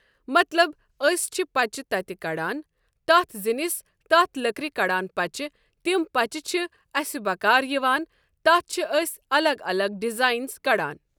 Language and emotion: Kashmiri, neutral